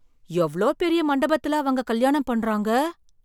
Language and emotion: Tamil, surprised